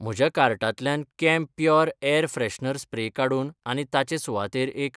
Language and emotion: Goan Konkani, neutral